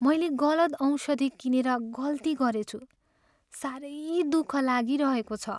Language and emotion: Nepali, sad